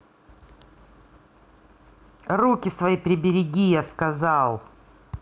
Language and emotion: Russian, angry